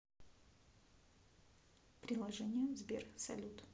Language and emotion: Russian, neutral